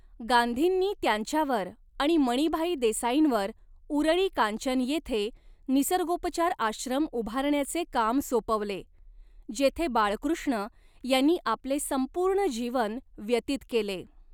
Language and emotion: Marathi, neutral